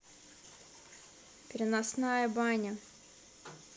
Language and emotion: Russian, neutral